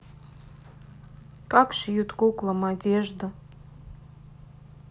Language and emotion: Russian, sad